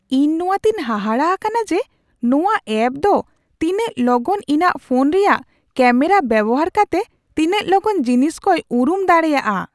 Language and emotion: Santali, surprised